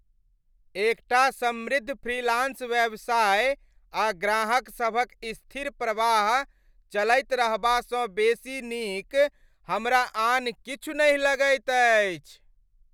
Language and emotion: Maithili, happy